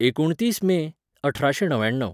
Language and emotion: Goan Konkani, neutral